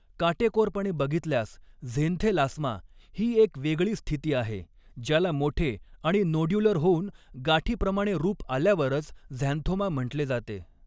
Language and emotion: Marathi, neutral